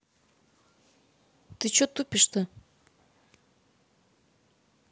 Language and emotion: Russian, angry